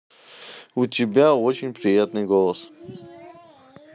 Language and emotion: Russian, neutral